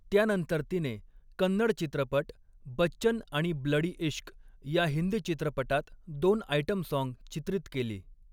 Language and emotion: Marathi, neutral